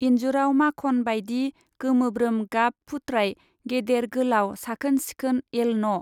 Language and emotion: Bodo, neutral